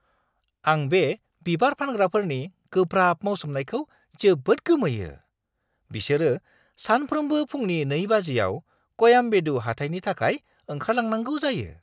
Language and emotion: Bodo, surprised